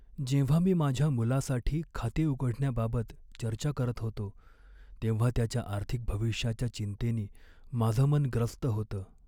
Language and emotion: Marathi, sad